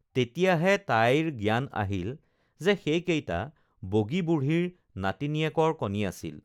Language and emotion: Assamese, neutral